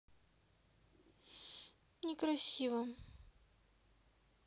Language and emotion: Russian, sad